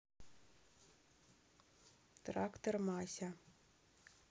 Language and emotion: Russian, neutral